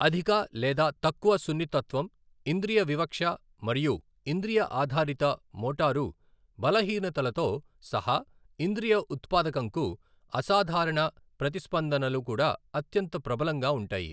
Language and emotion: Telugu, neutral